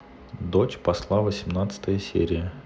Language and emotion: Russian, neutral